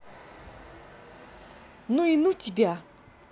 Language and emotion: Russian, angry